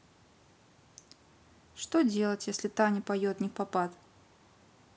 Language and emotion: Russian, neutral